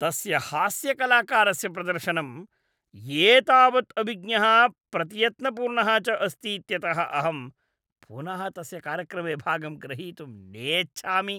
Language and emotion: Sanskrit, disgusted